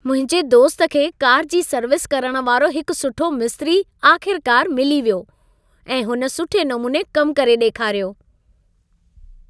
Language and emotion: Sindhi, happy